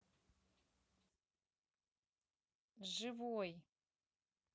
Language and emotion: Russian, neutral